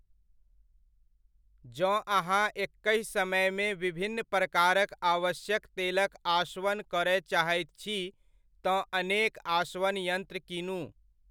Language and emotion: Maithili, neutral